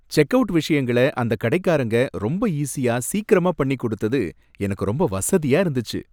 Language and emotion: Tamil, happy